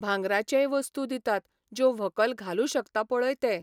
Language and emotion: Goan Konkani, neutral